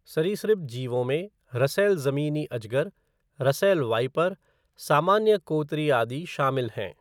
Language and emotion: Hindi, neutral